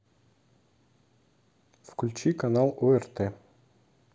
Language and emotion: Russian, neutral